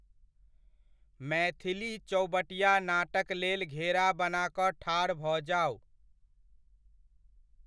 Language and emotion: Maithili, neutral